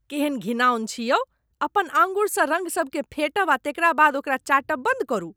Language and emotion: Maithili, disgusted